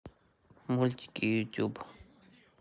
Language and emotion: Russian, neutral